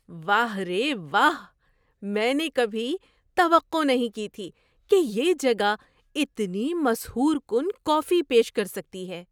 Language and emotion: Urdu, surprised